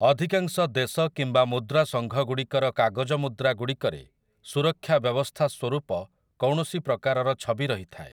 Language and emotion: Odia, neutral